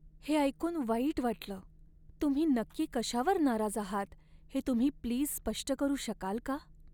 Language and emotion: Marathi, sad